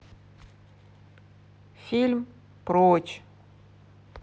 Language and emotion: Russian, neutral